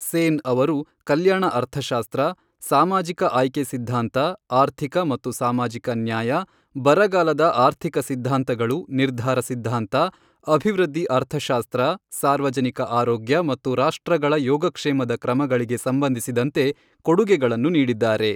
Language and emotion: Kannada, neutral